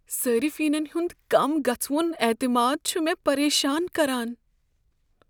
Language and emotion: Kashmiri, fearful